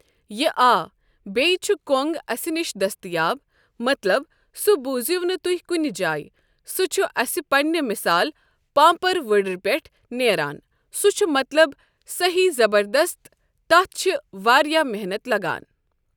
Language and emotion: Kashmiri, neutral